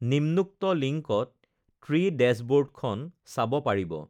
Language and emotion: Assamese, neutral